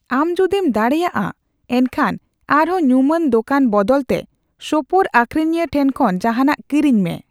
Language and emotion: Santali, neutral